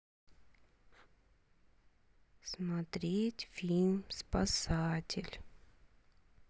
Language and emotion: Russian, sad